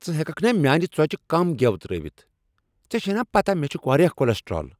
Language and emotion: Kashmiri, angry